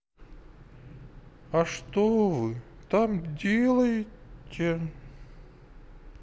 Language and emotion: Russian, sad